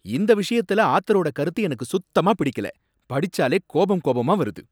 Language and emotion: Tamil, angry